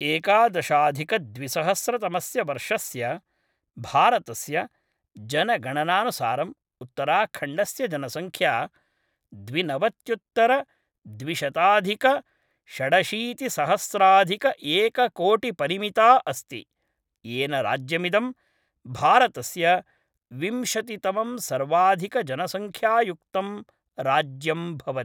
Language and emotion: Sanskrit, neutral